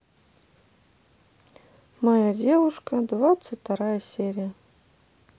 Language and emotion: Russian, sad